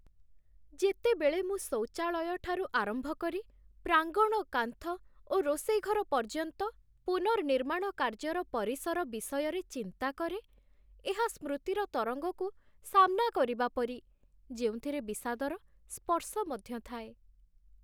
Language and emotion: Odia, sad